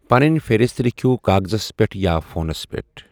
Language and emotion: Kashmiri, neutral